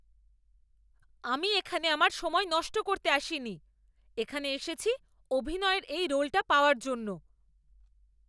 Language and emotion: Bengali, angry